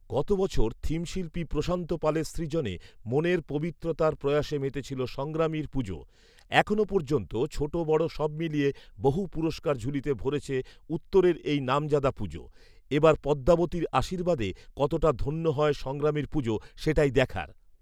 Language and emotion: Bengali, neutral